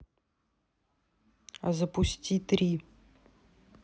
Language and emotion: Russian, neutral